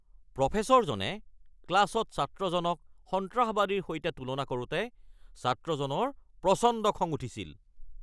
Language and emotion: Assamese, angry